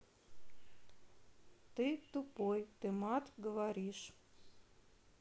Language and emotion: Russian, neutral